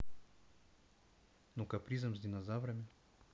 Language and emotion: Russian, neutral